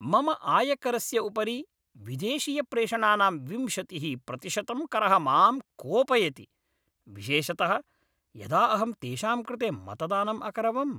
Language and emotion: Sanskrit, angry